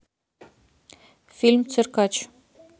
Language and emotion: Russian, neutral